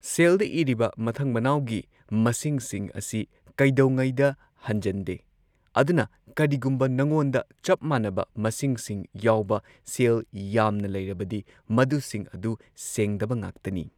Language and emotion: Manipuri, neutral